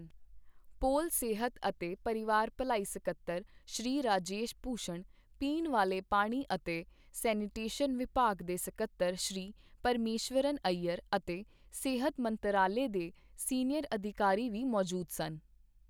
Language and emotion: Punjabi, neutral